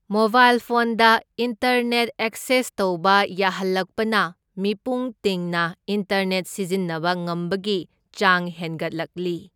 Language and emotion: Manipuri, neutral